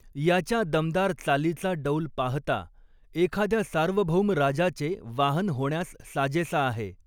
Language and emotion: Marathi, neutral